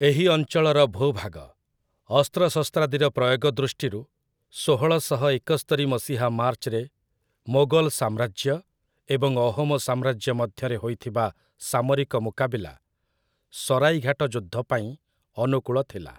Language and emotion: Odia, neutral